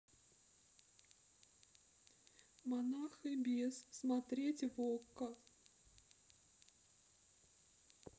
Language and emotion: Russian, sad